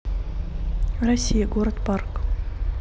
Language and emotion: Russian, neutral